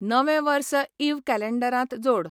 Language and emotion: Goan Konkani, neutral